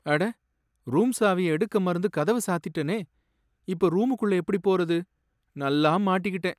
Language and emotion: Tamil, sad